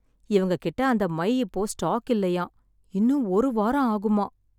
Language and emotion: Tamil, sad